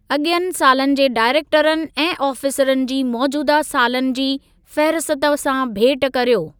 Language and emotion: Sindhi, neutral